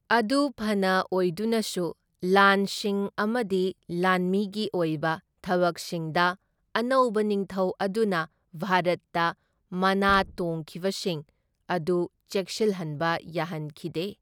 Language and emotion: Manipuri, neutral